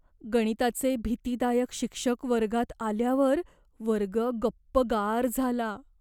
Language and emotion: Marathi, fearful